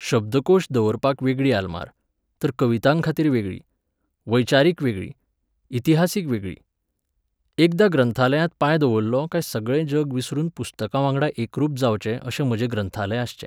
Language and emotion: Goan Konkani, neutral